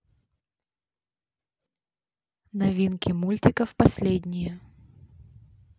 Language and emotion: Russian, neutral